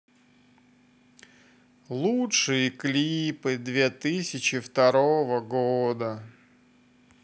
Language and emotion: Russian, sad